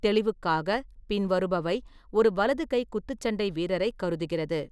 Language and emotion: Tamil, neutral